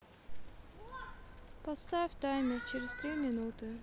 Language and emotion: Russian, neutral